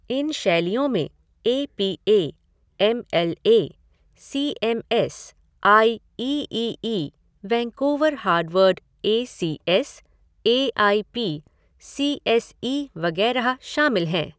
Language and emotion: Hindi, neutral